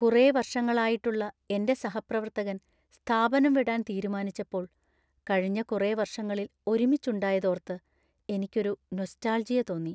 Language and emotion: Malayalam, sad